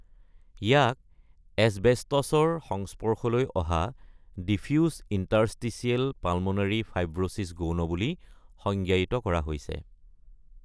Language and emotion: Assamese, neutral